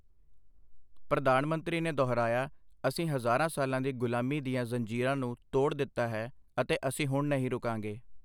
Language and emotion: Punjabi, neutral